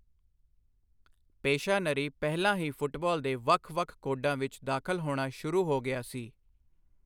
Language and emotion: Punjabi, neutral